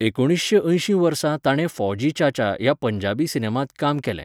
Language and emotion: Goan Konkani, neutral